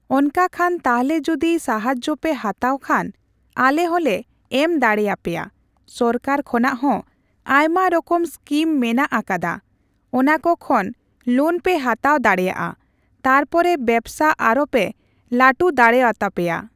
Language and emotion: Santali, neutral